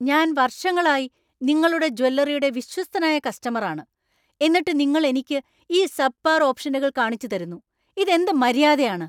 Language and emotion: Malayalam, angry